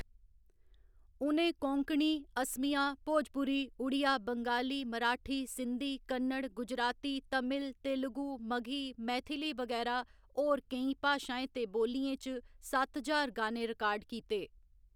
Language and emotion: Dogri, neutral